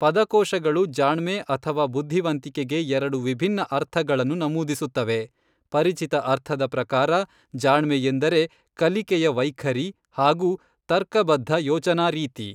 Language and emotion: Kannada, neutral